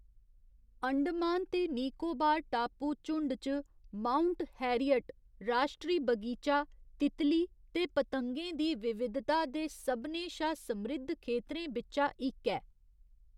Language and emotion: Dogri, neutral